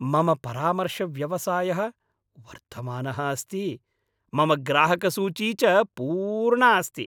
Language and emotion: Sanskrit, happy